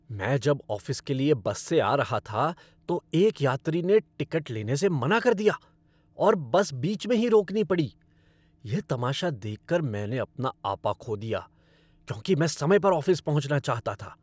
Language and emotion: Hindi, angry